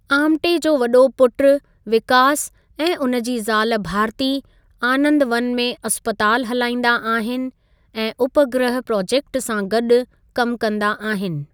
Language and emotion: Sindhi, neutral